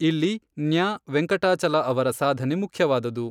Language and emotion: Kannada, neutral